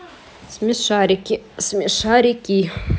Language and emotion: Russian, neutral